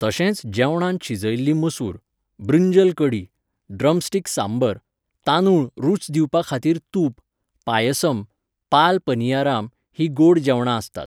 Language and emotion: Goan Konkani, neutral